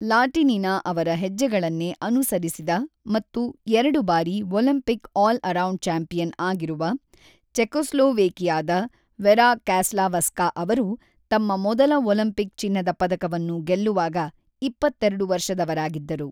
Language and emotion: Kannada, neutral